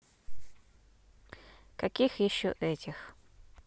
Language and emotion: Russian, neutral